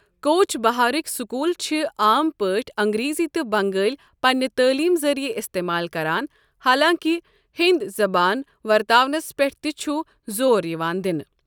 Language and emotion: Kashmiri, neutral